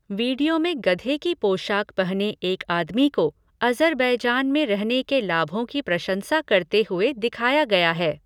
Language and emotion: Hindi, neutral